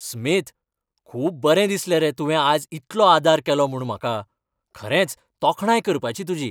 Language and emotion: Goan Konkani, happy